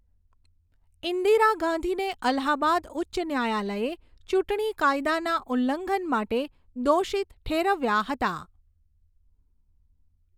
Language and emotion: Gujarati, neutral